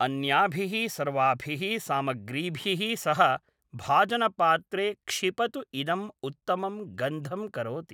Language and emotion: Sanskrit, neutral